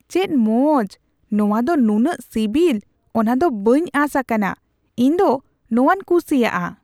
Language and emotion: Santali, surprised